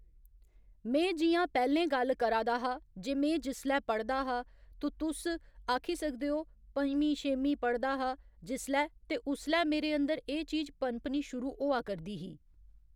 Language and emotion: Dogri, neutral